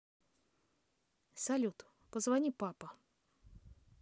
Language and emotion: Russian, neutral